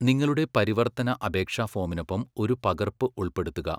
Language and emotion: Malayalam, neutral